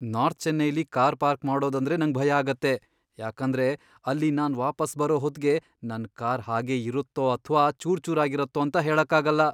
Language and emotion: Kannada, fearful